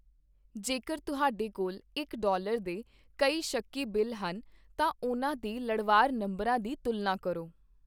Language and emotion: Punjabi, neutral